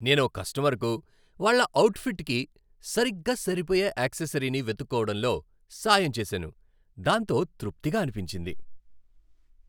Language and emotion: Telugu, happy